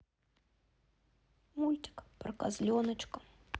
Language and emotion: Russian, sad